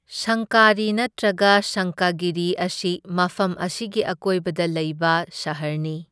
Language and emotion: Manipuri, neutral